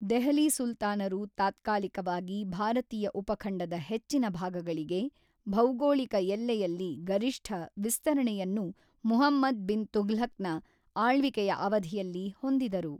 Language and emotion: Kannada, neutral